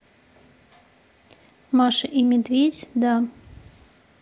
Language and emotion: Russian, neutral